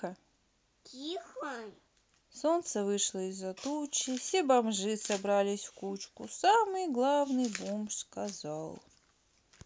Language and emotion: Russian, neutral